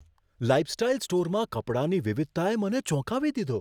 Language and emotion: Gujarati, surprised